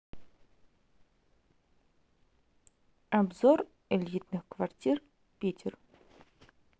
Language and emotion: Russian, neutral